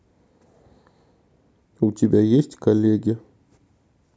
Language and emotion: Russian, neutral